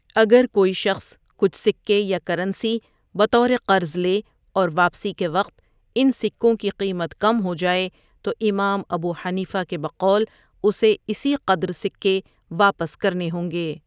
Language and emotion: Urdu, neutral